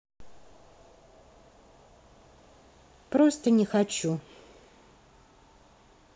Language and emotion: Russian, sad